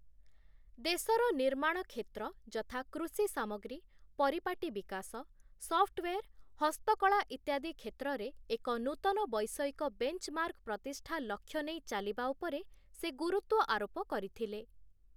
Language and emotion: Odia, neutral